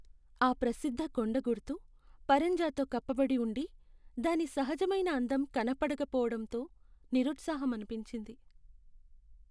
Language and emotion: Telugu, sad